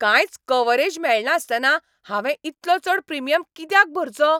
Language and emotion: Goan Konkani, angry